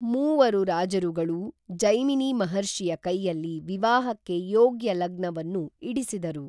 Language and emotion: Kannada, neutral